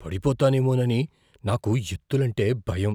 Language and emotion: Telugu, fearful